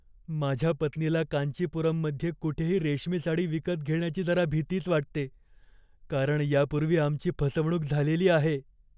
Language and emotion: Marathi, fearful